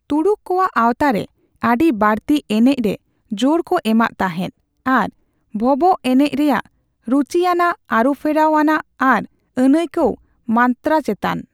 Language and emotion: Santali, neutral